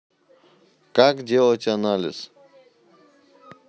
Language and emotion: Russian, neutral